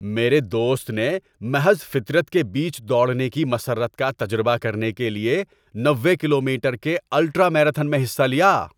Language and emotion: Urdu, happy